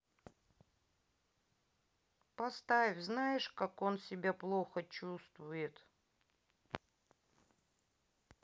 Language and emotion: Russian, neutral